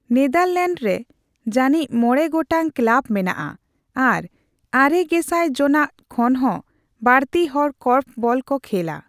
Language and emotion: Santali, neutral